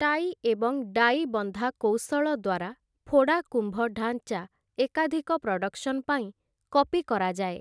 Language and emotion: Odia, neutral